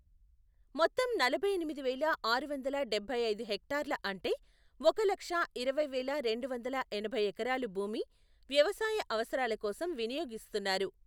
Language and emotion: Telugu, neutral